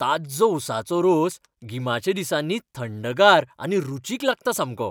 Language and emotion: Goan Konkani, happy